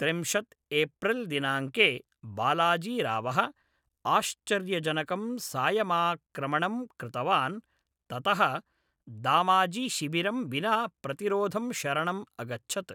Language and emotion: Sanskrit, neutral